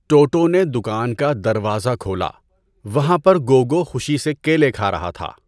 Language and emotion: Urdu, neutral